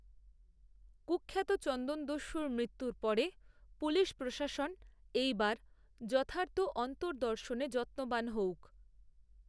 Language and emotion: Bengali, neutral